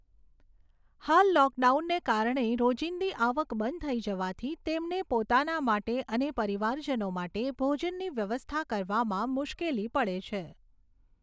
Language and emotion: Gujarati, neutral